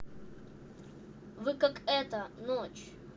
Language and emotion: Russian, neutral